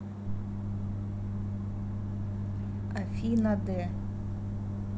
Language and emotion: Russian, neutral